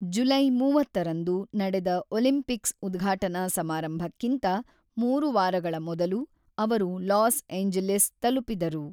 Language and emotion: Kannada, neutral